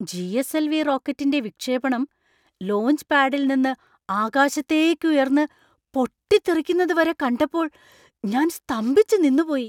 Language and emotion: Malayalam, surprised